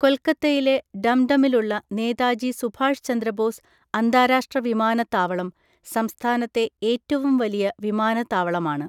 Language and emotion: Malayalam, neutral